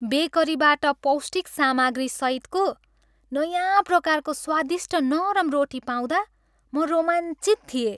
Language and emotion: Nepali, happy